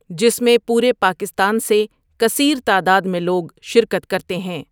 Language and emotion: Urdu, neutral